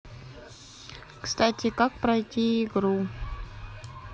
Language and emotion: Russian, neutral